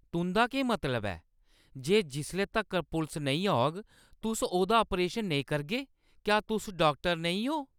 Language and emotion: Dogri, angry